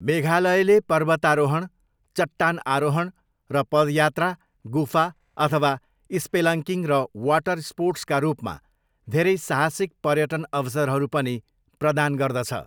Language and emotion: Nepali, neutral